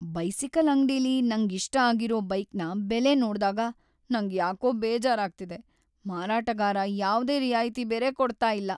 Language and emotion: Kannada, sad